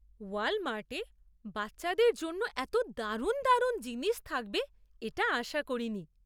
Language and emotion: Bengali, surprised